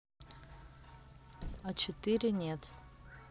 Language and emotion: Russian, neutral